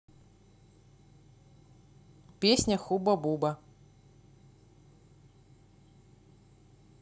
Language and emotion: Russian, neutral